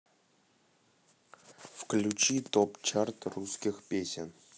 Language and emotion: Russian, neutral